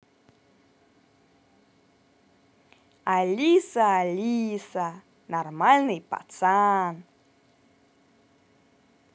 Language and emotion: Russian, positive